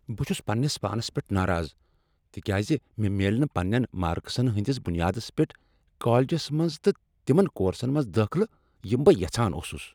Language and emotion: Kashmiri, angry